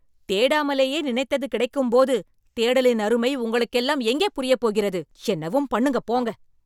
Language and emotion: Tamil, angry